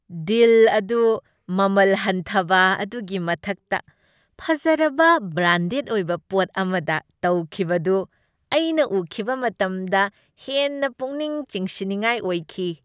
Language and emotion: Manipuri, happy